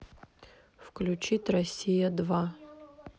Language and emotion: Russian, neutral